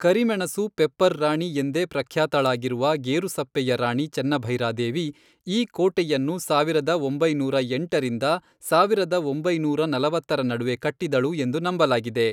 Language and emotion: Kannada, neutral